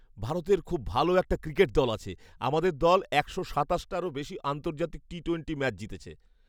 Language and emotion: Bengali, happy